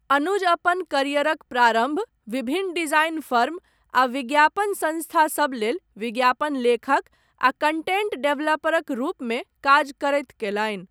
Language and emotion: Maithili, neutral